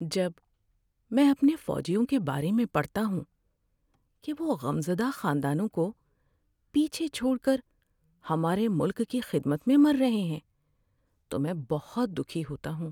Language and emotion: Urdu, sad